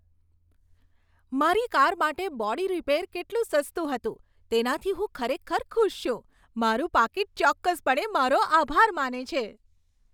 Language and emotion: Gujarati, happy